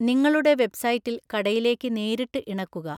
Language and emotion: Malayalam, neutral